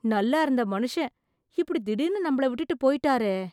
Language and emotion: Tamil, surprised